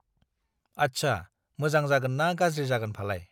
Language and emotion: Bodo, neutral